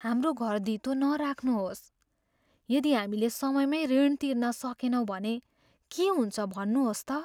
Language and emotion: Nepali, fearful